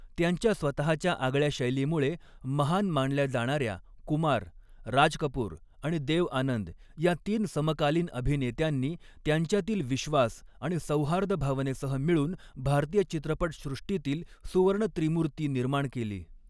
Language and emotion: Marathi, neutral